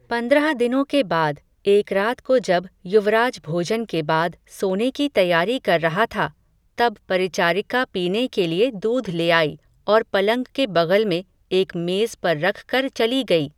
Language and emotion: Hindi, neutral